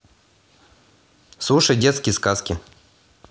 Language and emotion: Russian, neutral